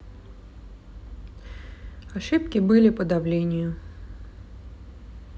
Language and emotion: Russian, neutral